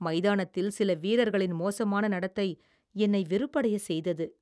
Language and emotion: Tamil, disgusted